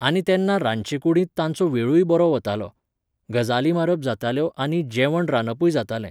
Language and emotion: Goan Konkani, neutral